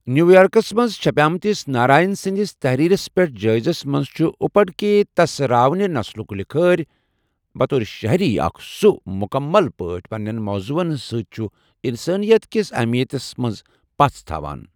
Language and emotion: Kashmiri, neutral